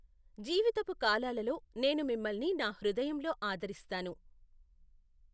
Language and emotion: Telugu, neutral